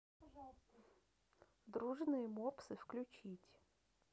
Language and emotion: Russian, neutral